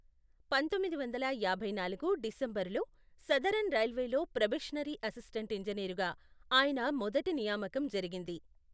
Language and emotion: Telugu, neutral